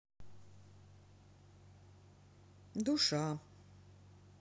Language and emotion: Russian, sad